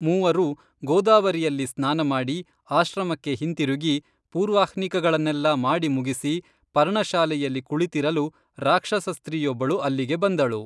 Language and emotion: Kannada, neutral